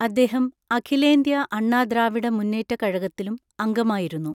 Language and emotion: Malayalam, neutral